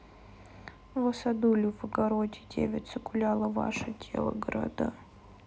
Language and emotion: Russian, sad